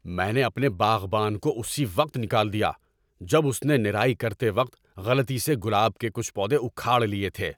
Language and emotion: Urdu, angry